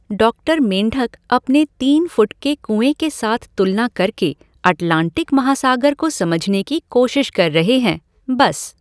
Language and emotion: Hindi, neutral